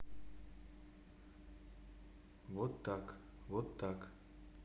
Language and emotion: Russian, neutral